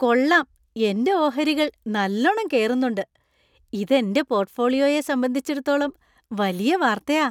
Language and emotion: Malayalam, happy